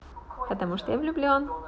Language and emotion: Russian, positive